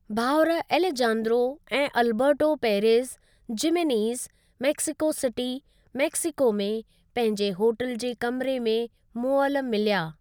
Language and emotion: Sindhi, neutral